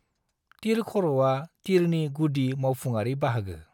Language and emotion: Bodo, neutral